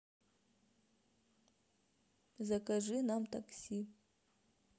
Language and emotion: Russian, neutral